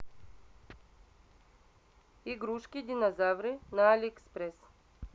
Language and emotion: Russian, neutral